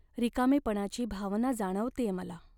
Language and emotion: Marathi, sad